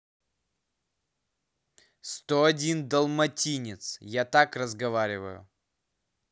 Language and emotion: Russian, angry